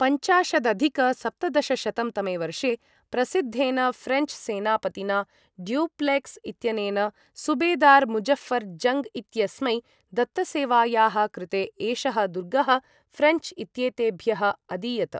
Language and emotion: Sanskrit, neutral